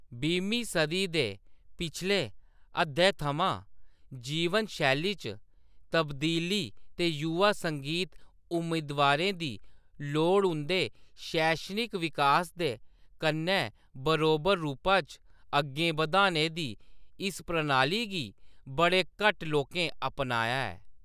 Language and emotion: Dogri, neutral